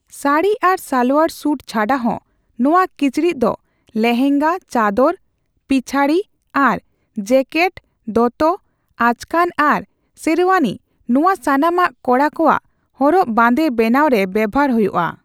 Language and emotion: Santali, neutral